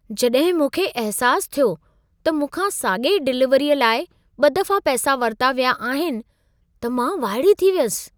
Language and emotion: Sindhi, surprised